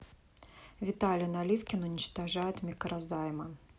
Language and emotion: Russian, neutral